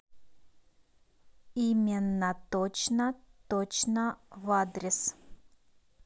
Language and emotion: Russian, neutral